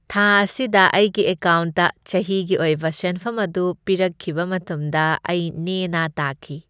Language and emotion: Manipuri, happy